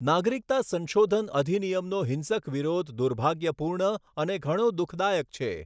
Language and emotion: Gujarati, neutral